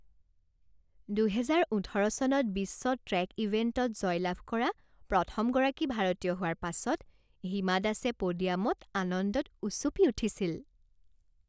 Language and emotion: Assamese, happy